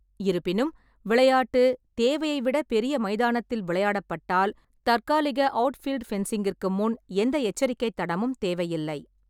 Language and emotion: Tamil, neutral